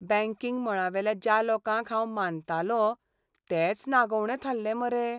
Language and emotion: Goan Konkani, sad